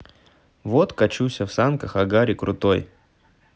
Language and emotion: Russian, neutral